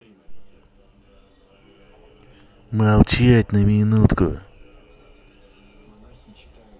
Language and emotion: Russian, angry